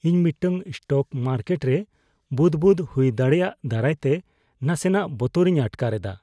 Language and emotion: Santali, fearful